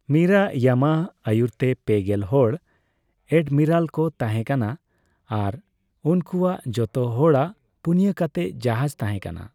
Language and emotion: Santali, neutral